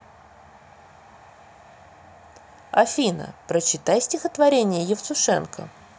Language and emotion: Russian, neutral